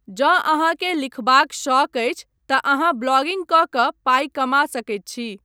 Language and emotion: Maithili, neutral